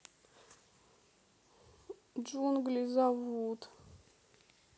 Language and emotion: Russian, sad